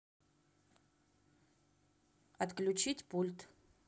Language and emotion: Russian, neutral